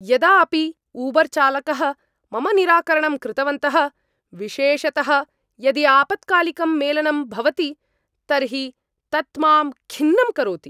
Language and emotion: Sanskrit, angry